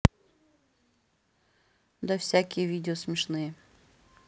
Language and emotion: Russian, neutral